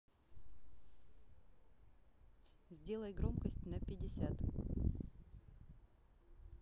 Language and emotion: Russian, neutral